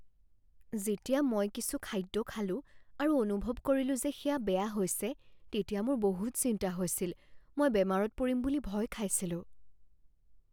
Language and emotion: Assamese, fearful